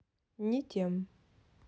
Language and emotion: Russian, neutral